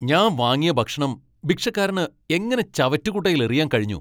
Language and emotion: Malayalam, angry